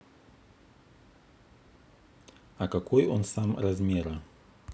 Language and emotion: Russian, neutral